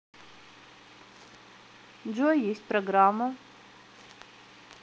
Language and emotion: Russian, neutral